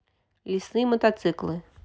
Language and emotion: Russian, neutral